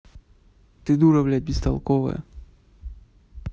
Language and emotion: Russian, angry